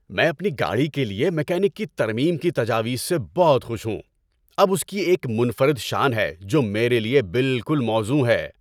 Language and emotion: Urdu, happy